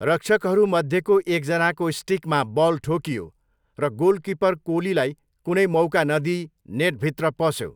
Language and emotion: Nepali, neutral